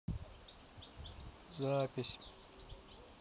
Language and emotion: Russian, neutral